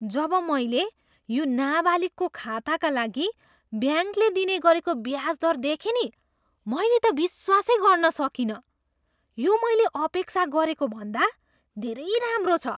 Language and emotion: Nepali, surprised